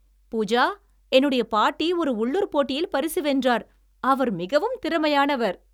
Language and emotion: Tamil, happy